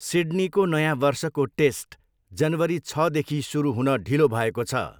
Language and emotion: Nepali, neutral